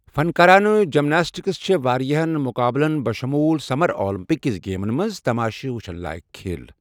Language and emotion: Kashmiri, neutral